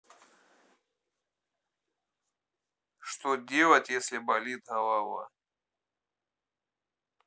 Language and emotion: Russian, neutral